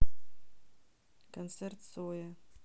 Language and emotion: Russian, neutral